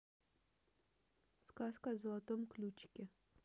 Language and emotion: Russian, neutral